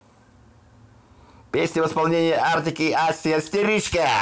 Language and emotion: Russian, positive